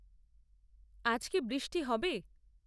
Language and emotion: Bengali, neutral